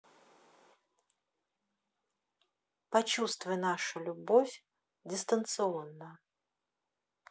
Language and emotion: Russian, neutral